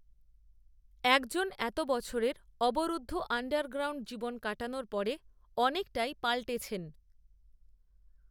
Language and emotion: Bengali, neutral